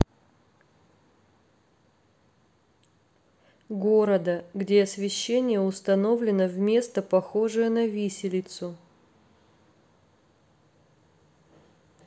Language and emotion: Russian, neutral